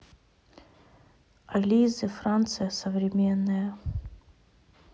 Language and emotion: Russian, sad